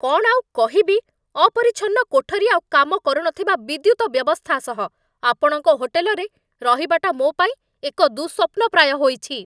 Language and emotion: Odia, angry